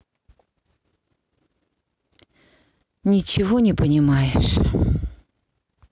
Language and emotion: Russian, sad